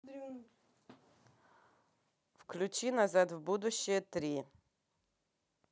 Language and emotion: Russian, neutral